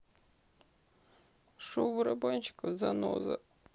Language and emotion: Russian, sad